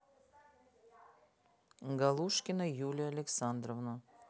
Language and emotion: Russian, neutral